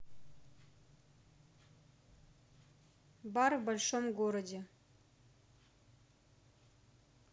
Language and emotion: Russian, neutral